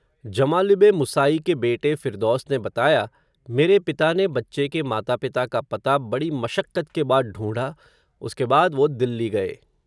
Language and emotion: Hindi, neutral